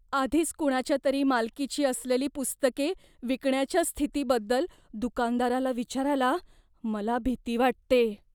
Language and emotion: Marathi, fearful